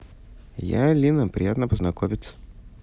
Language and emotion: Russian, neutral